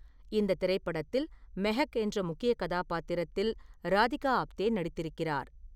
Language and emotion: Tamil, neutral